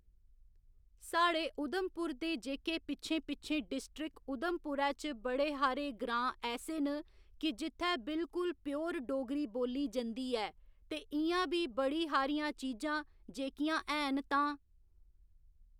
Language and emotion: Dogri, neutral